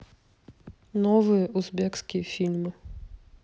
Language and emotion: Russian, neutral